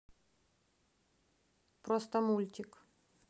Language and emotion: Russian, neutral